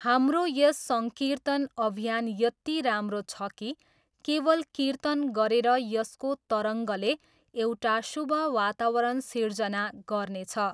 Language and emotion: Nepali, neutral